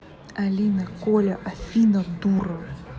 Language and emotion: Russian, angry